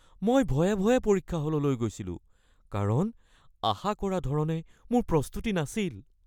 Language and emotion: Assamese, fearful